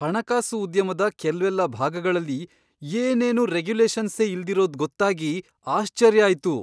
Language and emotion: Kannada, surprised